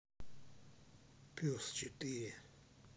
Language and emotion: Russian, neutral